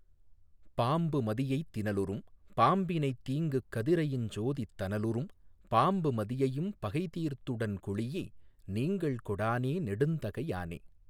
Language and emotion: Tamil, neutral